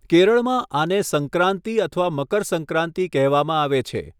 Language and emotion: Gujarati, neutral